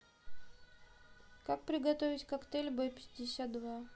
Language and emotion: Russian, neutral